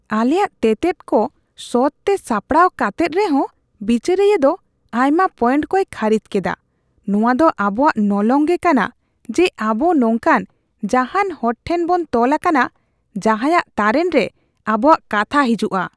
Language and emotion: Santali, disgusted